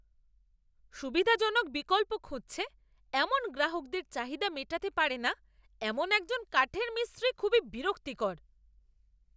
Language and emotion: Bengali, angry